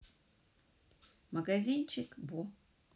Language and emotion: Russian, neutral